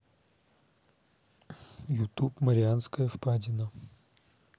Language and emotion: Russian, neutral